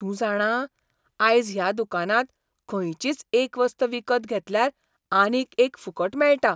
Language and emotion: Goan Konkani, surprised